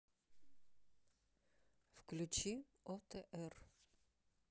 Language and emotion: Russian, neutral